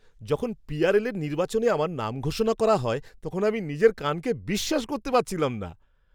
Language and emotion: Bengali, surprised